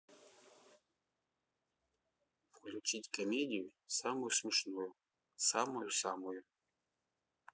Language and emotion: Russian, neutral